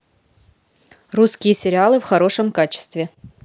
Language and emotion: Russian, neutral